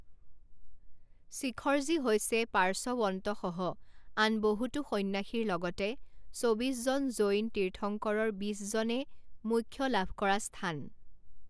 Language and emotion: Assamese, neutral